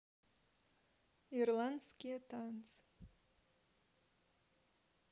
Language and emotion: Russian, neutral